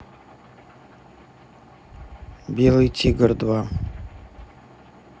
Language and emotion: Russian, neutral